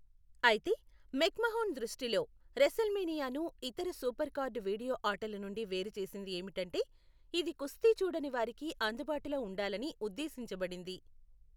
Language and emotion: Telugu, neutral